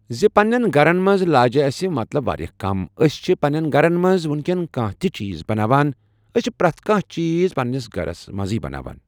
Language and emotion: Kashmiri, neutral